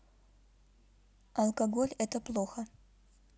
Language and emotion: Russian, neutral